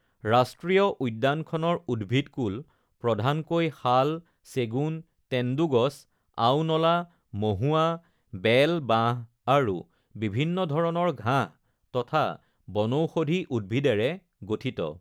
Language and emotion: Assamese, neutral